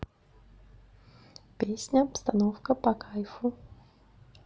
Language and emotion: Russian, neutral